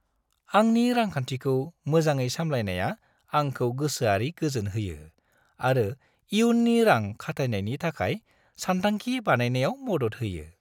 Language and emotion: Bodo, happy